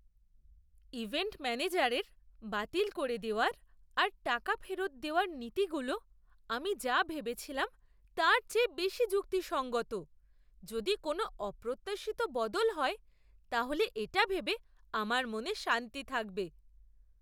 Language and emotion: Bengali, surprised